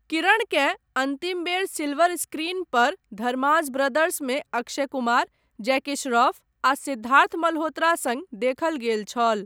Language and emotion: Maithili, neutral